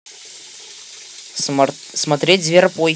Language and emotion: Russian, positive